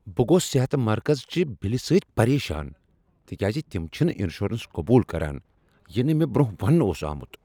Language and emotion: Kashmiri, angry